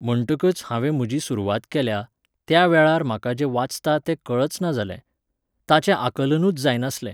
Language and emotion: Goan Konkani, neutral